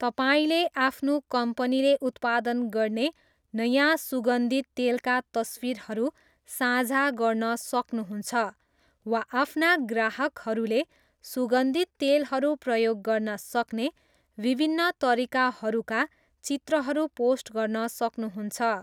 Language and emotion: Nepali, neutral